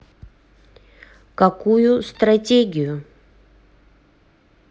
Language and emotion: Russian, neutral